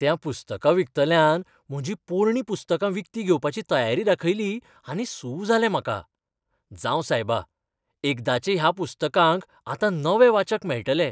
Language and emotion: Goan Konkani, happy